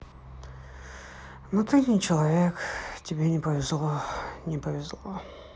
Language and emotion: Russian, sad